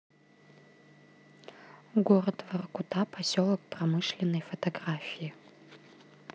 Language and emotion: Russian, neutral